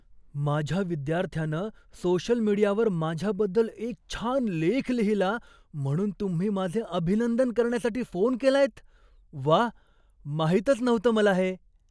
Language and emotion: Marathi, surprised